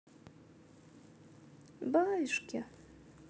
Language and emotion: Russian, positive